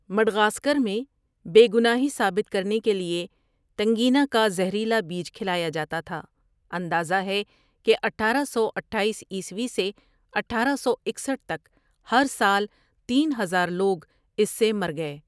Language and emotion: Urdu, neutral